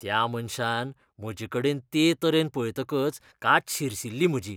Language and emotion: Goan Konkani, disgusted